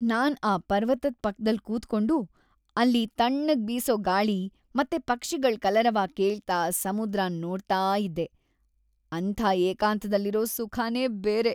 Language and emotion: Kannada, happy